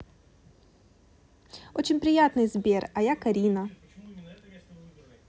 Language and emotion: Russian, positive